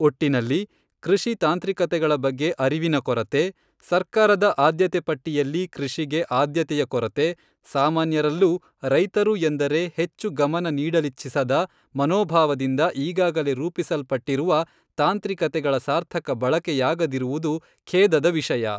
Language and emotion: Kannada, neutral